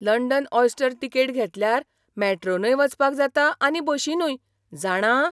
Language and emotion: Goan Konkani, surprised